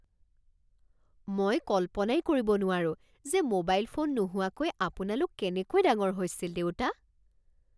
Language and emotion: Assamese, surprised